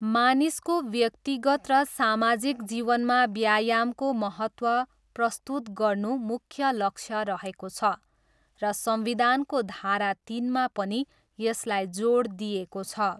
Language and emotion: Nepali, neutral